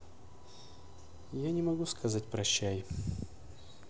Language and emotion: Russian, sad